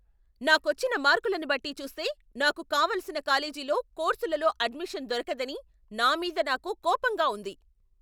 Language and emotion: Telugu, angry